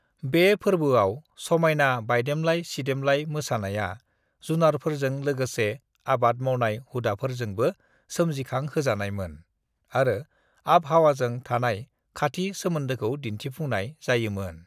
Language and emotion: Bodo, neutral